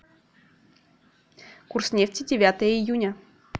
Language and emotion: Russian, neutral